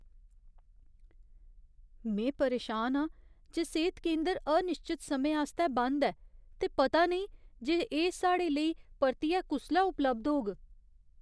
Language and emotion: Dogri, fearful